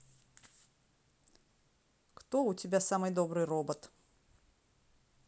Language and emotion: Russian, neutral